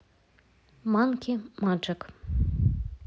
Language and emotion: Russian, neutral